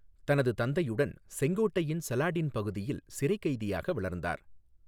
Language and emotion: Tamil, neutral